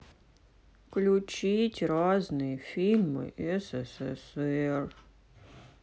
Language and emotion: Russian, sad